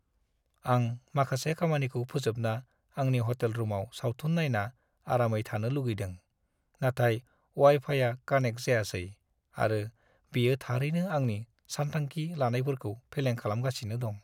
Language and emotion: Bodo, sad